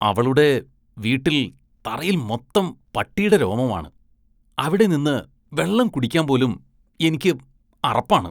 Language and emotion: Malayalam, disgusted